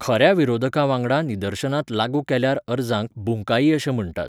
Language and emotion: Goan Konkani, neutral